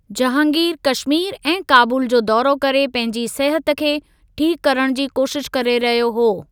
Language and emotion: Sindhi, neutral